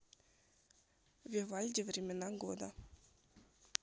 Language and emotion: Russian, neutral